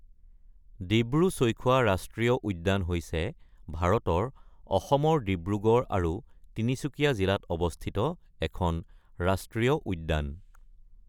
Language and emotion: Assamese, neutral